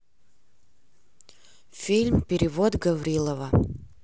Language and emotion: Russian, neutral